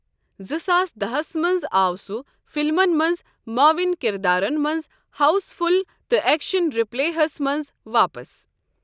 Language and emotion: Kashmiri, neutral